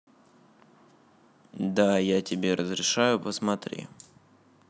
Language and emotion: Russian, neutral